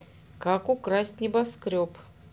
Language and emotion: Russian, neutral